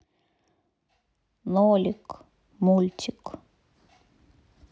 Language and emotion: Russian, sad